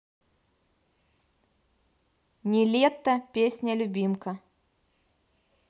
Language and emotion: Russian, neutral